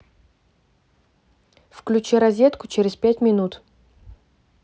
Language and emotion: Russian, neutral